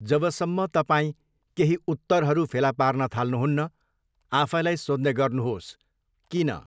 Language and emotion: Nepali, neutral